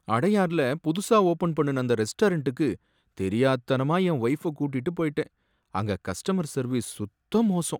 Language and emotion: Tamil, sad